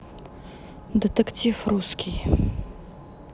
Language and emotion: Russian, neutral